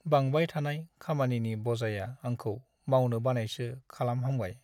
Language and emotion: Bodo, sad